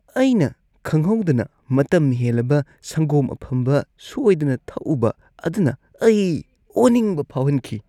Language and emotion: Manipuri, disgusted